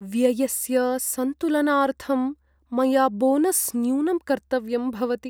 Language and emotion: Sanskrit, sad